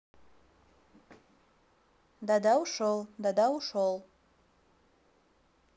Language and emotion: Russian, neutral